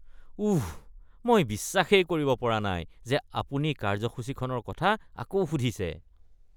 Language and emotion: Assamese, disgusted